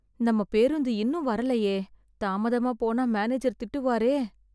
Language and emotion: Tamil, sad